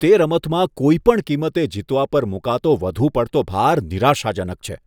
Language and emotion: Gujarati, disgusted